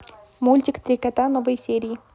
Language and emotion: Russian, positive